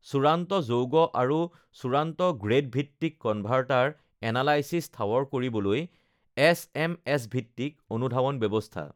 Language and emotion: Assamese, neutral